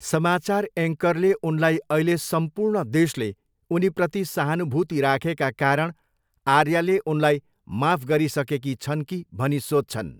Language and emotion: Nepali, neutral